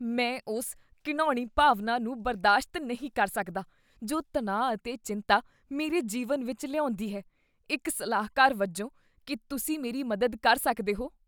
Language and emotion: Punjabi, disgusted